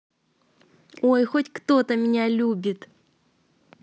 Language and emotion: Russian, positive